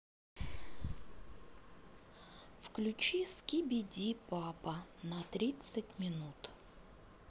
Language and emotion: Russian, neutral